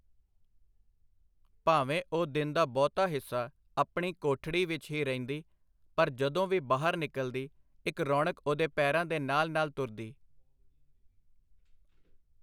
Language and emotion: Punjabi, neutral